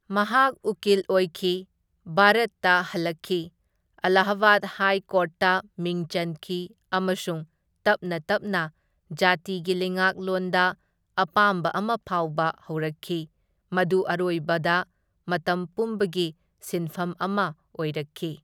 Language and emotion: Manipuri, neutral